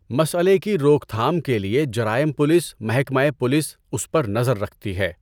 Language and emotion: Urdu, neutral